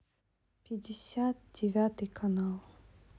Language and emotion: Russian, sad